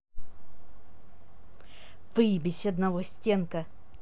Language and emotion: Russian, angry